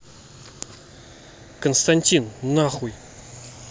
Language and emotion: Russian, angry